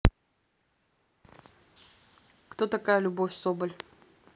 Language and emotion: Russian, neutral